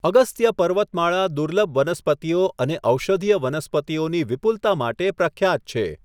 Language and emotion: Gujarati, neutral